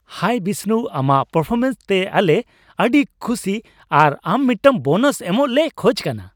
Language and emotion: Santali, happy